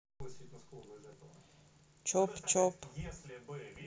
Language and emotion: Russian, neutral